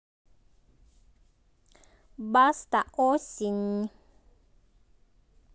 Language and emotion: Russian, positive